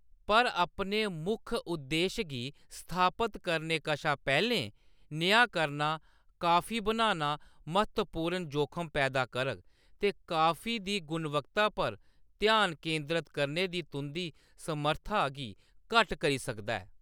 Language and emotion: Dogri, neutral